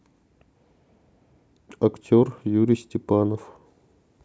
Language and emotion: Russian, neutral